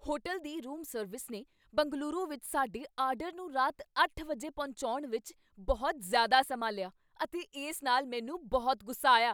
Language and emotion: Punjabi, angry